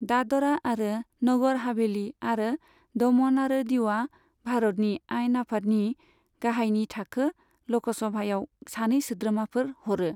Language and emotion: Bodo, neutral